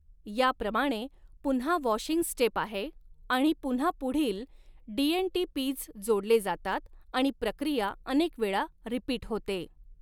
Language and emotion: Marathi, neutral